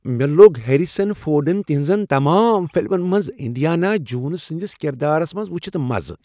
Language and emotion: Kashmiri, happy